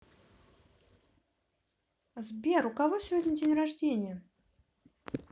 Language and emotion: Russian, positive